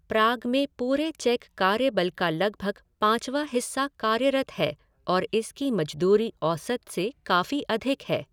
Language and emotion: Hindi, neutral